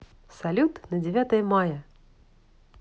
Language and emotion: Russian, positive